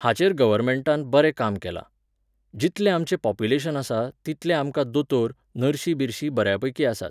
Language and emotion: Goan Konkani, neutral